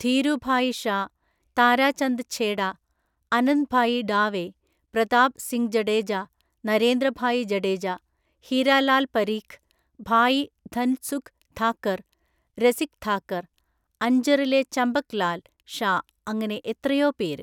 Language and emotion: Malayalam, neutral